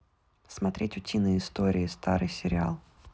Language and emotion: Russian, neutral